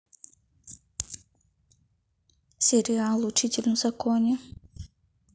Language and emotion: Russian, neutral